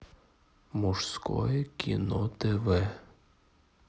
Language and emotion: Russian, neutral